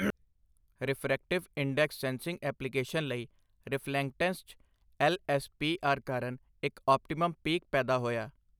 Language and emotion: Punjabi, neutral